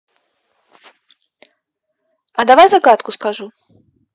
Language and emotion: Russian, neutral